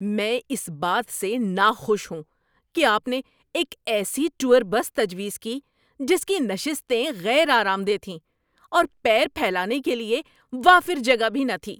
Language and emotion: Urdu, angry